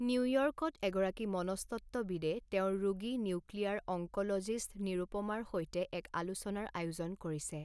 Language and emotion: Assamese, neutral